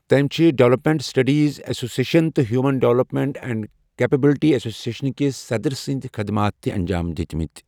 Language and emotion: Kashmiri, neutral